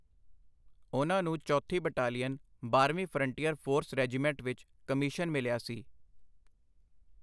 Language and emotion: Punjabi, neutral